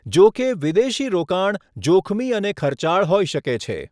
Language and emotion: Gujarati, neutral